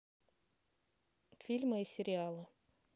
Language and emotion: Russian, neutral